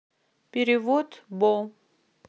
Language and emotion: Russian, neutral